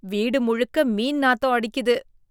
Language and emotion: Tamil, disgusted